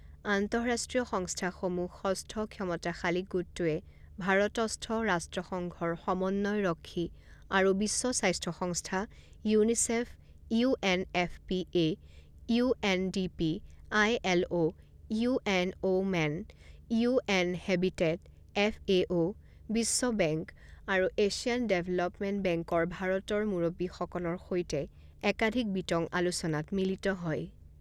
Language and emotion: Assamese, neutral